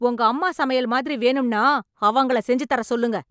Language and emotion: Tamil, angry